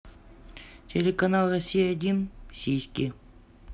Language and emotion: Russian, neutral